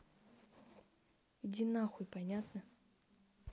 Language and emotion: Russian, angry